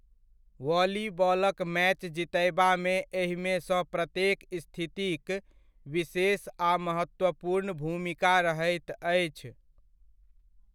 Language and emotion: Maithili, neutral